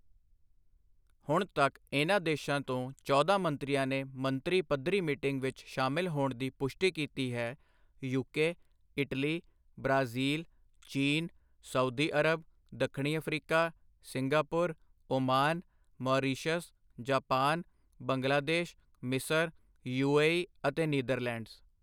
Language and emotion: Punjabi, neutral